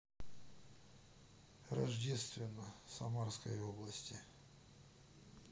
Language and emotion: Russian, neutral